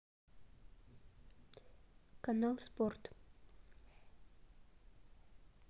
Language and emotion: Russian, neutral